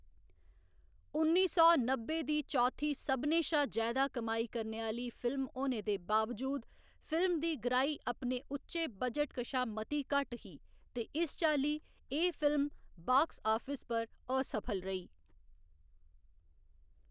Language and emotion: Dogri, neutral